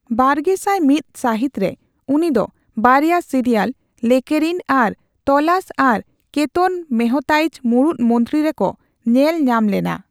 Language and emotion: Santali, neutral